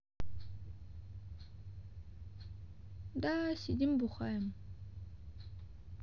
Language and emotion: Russian, neutral